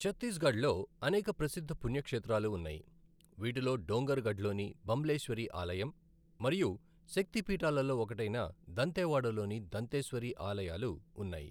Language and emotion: Telugu, neutral